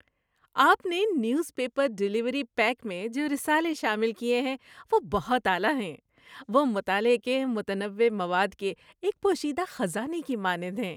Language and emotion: Urdu, happy